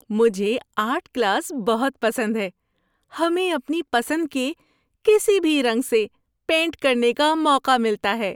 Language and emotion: Urdu, happy